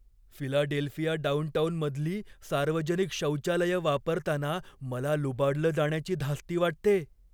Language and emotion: Marathi, fearful